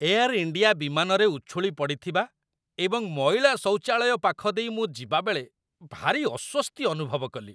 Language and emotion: Odia, disgusted